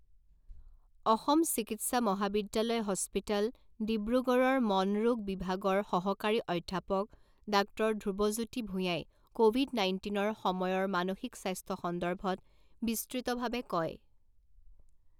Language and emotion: Assamese, neutral